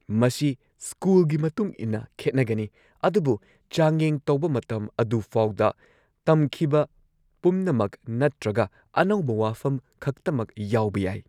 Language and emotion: Manipuri, neutral